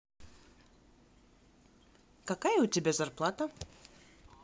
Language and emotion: Russian, positive